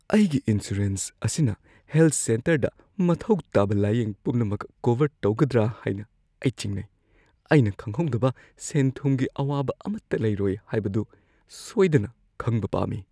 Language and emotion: Manipuri, fearful